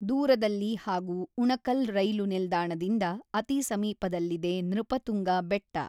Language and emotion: Kannada, neutral